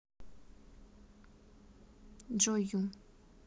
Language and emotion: Russian, neutral